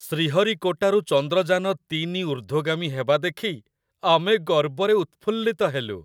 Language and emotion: Odia, happy